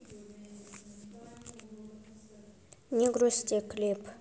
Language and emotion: Russian, neutral